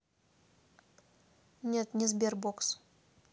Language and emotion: Russian, neutral